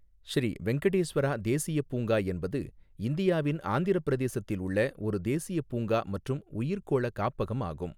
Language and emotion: Tamil, neutral